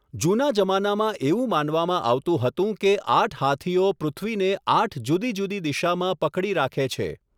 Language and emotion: Gujarati, neutral